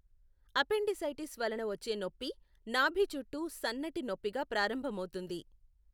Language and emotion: Telugu, neutral